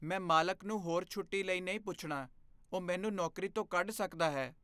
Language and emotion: Punjabi, fearful